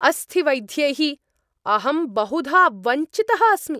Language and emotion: Sanskrit, angry